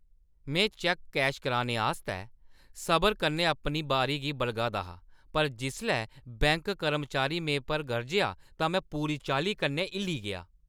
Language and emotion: Dogri, angry